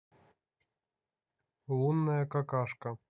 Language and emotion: Russian, neutral